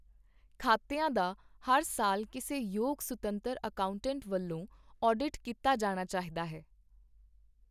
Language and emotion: Punjabi, neutral